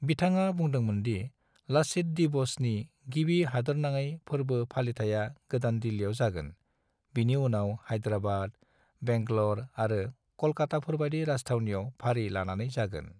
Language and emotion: Bodo, neutral